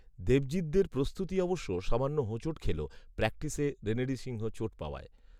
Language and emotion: Bengali, neutral